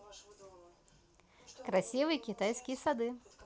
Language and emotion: Russian, positive